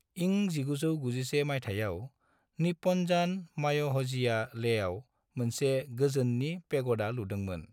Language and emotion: Bodo, neutral